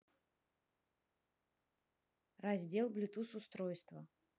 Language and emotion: Russian, neutral